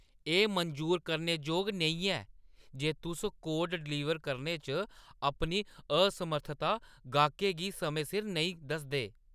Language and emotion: Dogri, angry